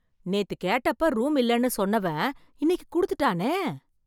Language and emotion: Tamil, surprised